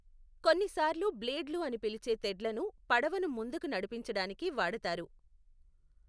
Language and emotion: Telugu, neutral